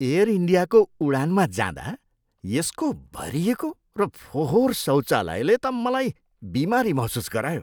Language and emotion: Nepali, disgusted